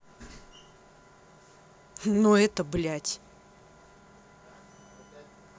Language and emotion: Russian, angry